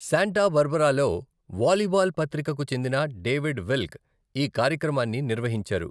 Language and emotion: Telugu, neutral